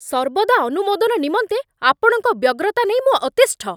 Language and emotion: Odia, angry